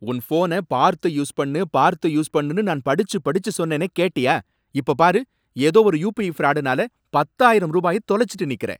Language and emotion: Tamil, angry